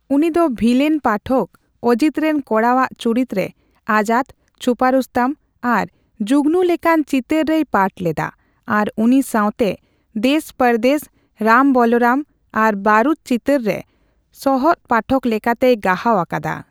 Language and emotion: Santali, neutral